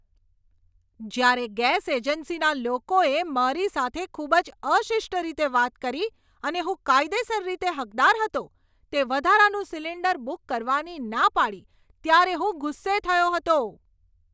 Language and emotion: Gujarati, angry